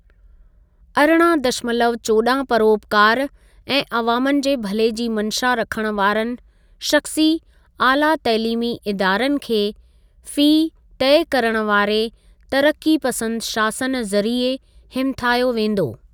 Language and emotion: Sindhi, neutral